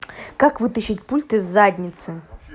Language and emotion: Russian, angry